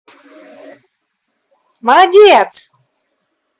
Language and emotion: Russian, positive